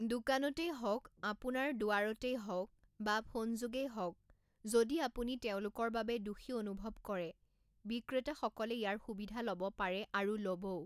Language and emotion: Assamese, neutral